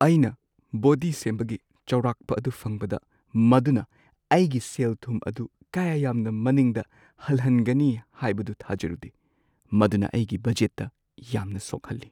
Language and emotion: Manipuri, sad